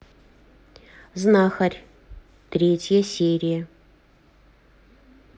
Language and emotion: Russian, neutral